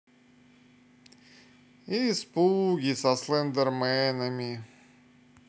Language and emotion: Russian, sad